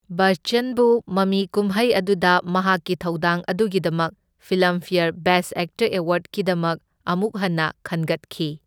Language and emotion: Manipuri, neutral